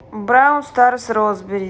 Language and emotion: Russian, neutral